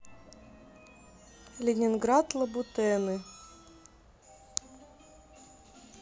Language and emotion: Russian, neutral